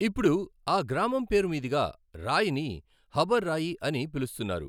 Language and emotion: Telugu, neutral